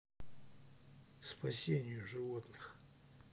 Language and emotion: Russian, neutral